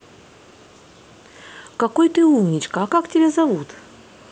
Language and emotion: Russian, positive